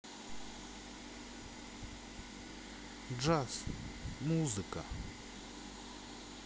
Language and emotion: Russian, neutral